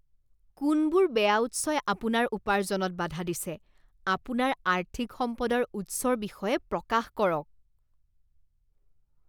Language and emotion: Assamese, disgusted